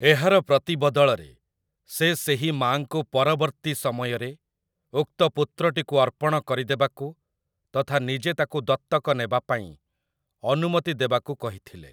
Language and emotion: Odia, neutral